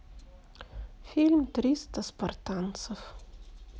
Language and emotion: Russian, sad